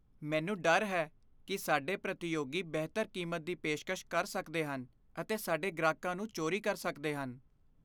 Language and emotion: Punjabi, fearful